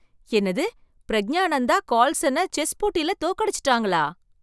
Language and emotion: Tamil, surprised